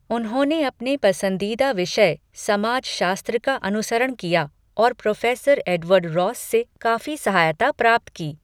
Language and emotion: Hindi, neutral